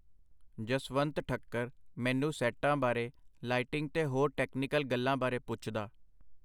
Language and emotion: Punjabi, neutral